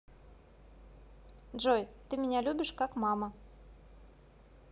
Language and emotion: Russian, neutral